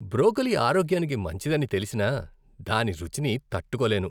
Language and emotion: Telugu, disgusted